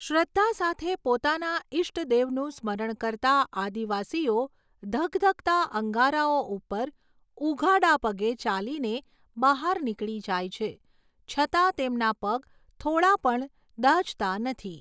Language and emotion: Gujarati, neutral